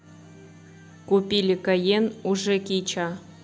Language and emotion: Russian, neutral